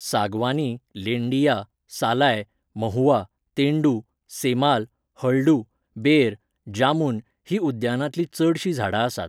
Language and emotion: Goan Konkani, neutral